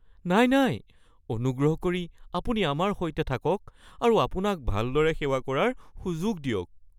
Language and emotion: Assamese, fearful